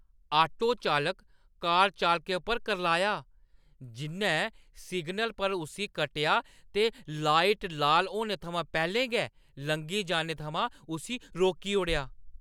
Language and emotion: Dogri, angry